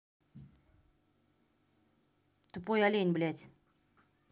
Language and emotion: Russian, angry